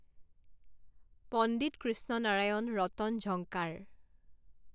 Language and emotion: Assamese, neutral